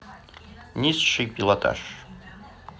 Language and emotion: Russian, neutral